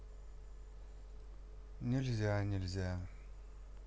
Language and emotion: Russian, sad